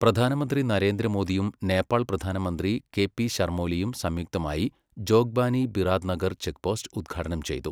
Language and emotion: Malayalam, neutral